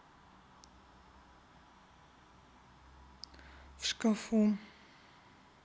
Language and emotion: Russian, neutral